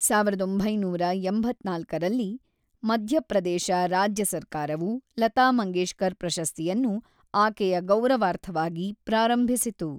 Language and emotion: Kannada, neutral